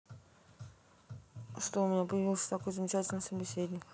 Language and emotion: Russian, neutral